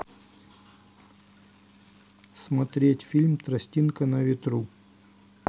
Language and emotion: Russian, neutral